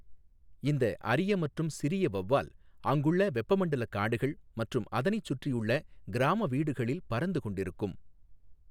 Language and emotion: Tamil, neutral